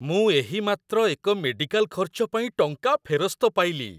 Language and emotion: Odia, happy